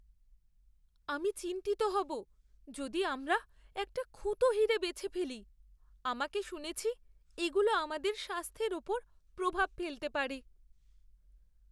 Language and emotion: Bengali, fearful